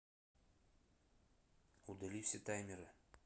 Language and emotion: Russian, neutral